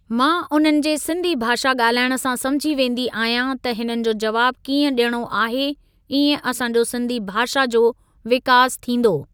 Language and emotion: Sindhi, neutral